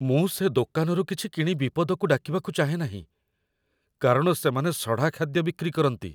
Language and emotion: Odia, fearful